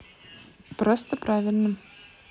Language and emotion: Russian, neutral